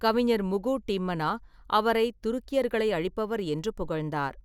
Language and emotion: Tamil, neutral